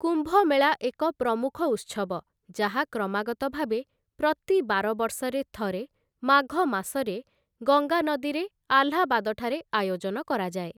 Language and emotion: Odia, neutral